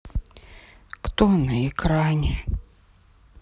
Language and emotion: Russian, sad